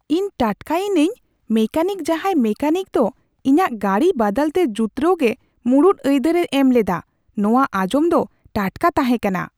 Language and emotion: Santali, surprised